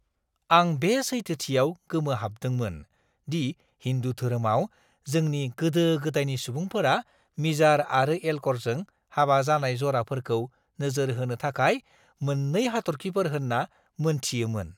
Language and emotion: Bodo, surprised